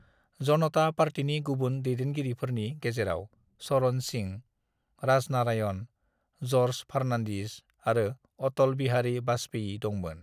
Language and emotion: Bodo, neutral